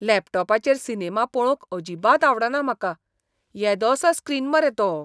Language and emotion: Goan Konkani, disgusted